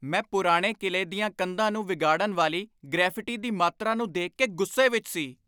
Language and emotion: Punjabi, angry